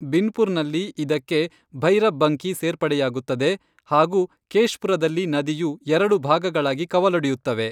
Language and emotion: Kannada, neutral